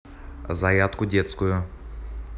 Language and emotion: Russian, neutral